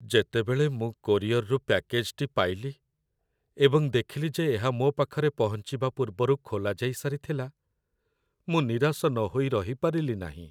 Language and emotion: Odia, sad